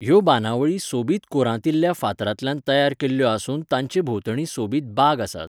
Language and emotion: Goan Konkani, neutral